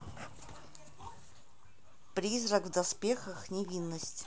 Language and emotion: Russian, neutral